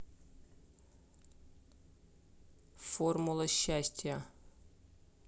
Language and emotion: Russian, neutral